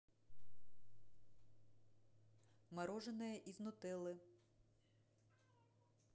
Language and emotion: Russian, neutral